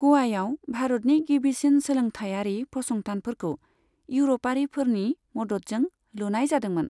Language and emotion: Bodo, neutral